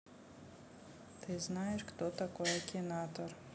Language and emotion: Russian, neutral